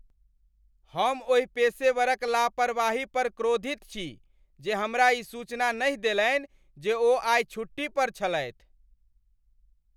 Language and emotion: Maithili, angry